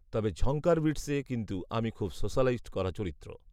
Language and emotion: Bengali, neutral